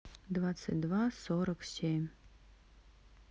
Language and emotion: Russian, neutral